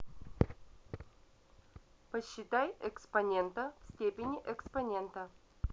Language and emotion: Russian, neutral